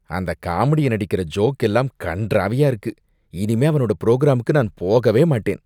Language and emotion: Tamil, disgusted